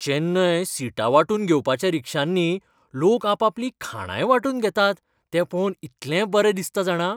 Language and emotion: Goan Konkani, happy